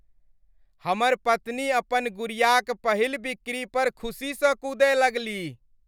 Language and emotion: Maithili, happy